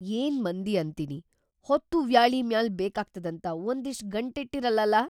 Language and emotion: Kannada, surprised